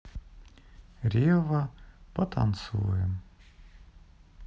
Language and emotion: Russian, sad